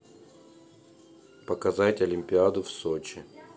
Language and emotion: Russian, neutral